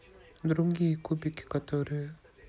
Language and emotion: Russian, neutral